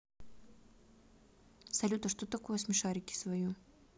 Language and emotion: Russian, neutral